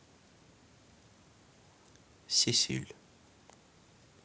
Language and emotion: Russian, neutral